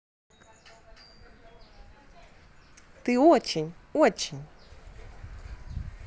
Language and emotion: Russian, positive